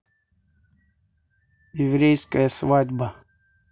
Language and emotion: Russian, neutral